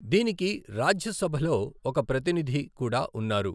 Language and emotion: Telugu, neutral